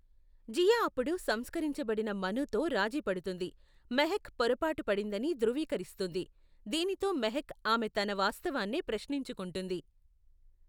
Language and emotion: Telugu, neutral